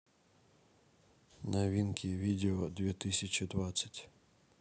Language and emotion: Russian, neutral